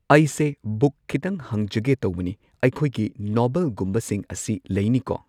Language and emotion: Manipuri, neutral